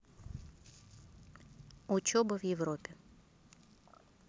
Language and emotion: Russian, neutral